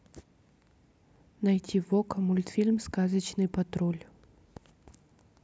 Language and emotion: Russian, neutral